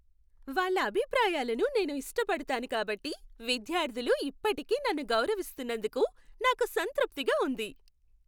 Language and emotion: Telugu, happy